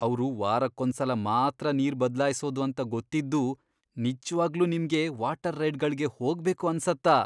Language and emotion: Kannada, disgusted